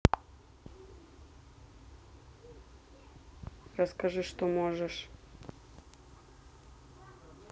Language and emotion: Russian, neutral